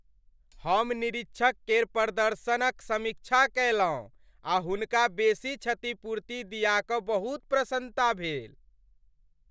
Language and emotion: Maithili, happy